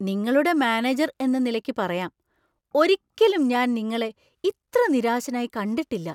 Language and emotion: Malayalam, surprised